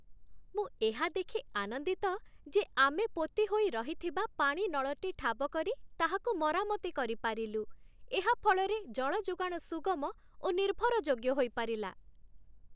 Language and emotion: Odia, happy